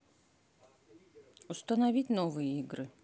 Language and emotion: Russian, neutral